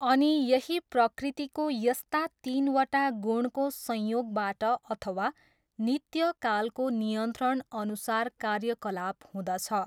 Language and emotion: Nepali, neutral